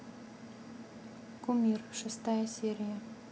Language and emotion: Russian, neutral